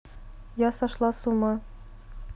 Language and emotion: Russian, neutral